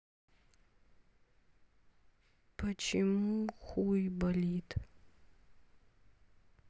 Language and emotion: Russian, sad